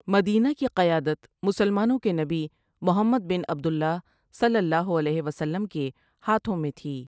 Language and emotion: Urdu, neutral